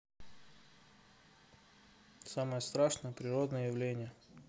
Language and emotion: Russian, neutral